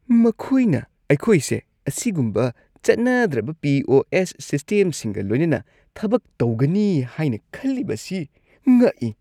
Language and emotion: Manipuri, disgusted